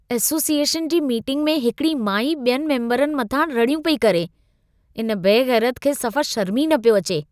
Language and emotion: Sindhi, disgusted